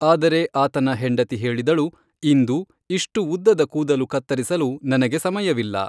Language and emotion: Kannada, neutral